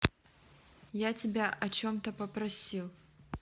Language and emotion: Russian, neutral